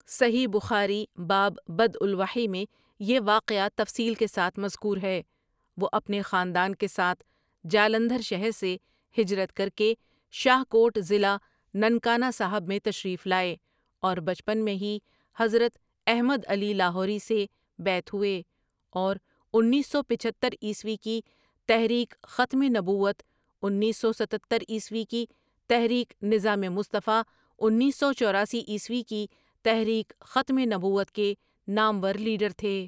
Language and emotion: Urdu, neutral